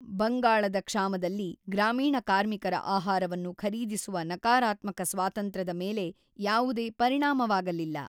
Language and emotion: Kannada, neutral